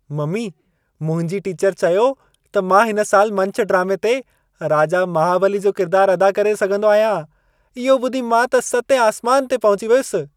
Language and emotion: Sindhi, happy